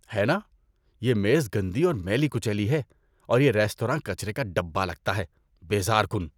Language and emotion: Urdu, disgusted